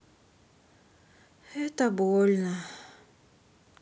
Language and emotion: Russian, sad